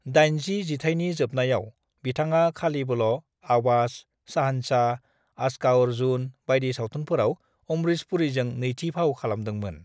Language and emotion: Bodo, neutral